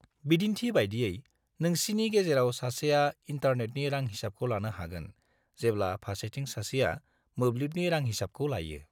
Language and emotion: Bodo, neutral